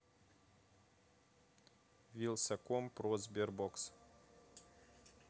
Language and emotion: Russian, neutral